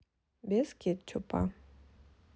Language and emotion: Russian, neutral